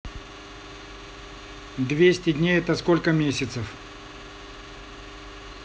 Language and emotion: Russian, neutral